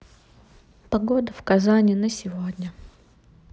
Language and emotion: Russian, sad